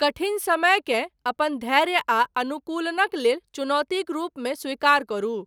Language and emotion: Maithili, neutral